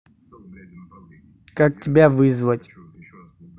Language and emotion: Russian, neutral